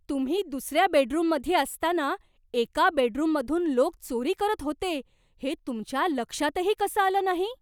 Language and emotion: Marathi, surprised